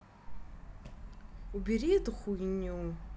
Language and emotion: Russian, angry